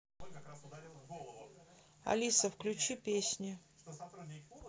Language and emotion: Russian, neutral